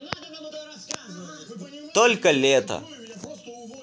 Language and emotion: Russian, positive